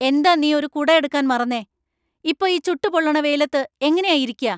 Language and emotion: Malayalam, angry